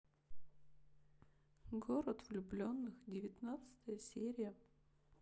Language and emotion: Russian, sad